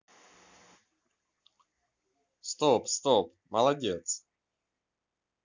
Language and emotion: Russian, positive